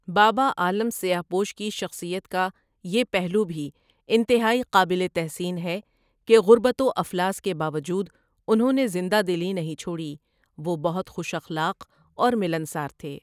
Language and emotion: Urdu, neutral